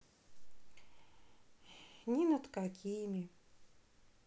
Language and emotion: Russian, sad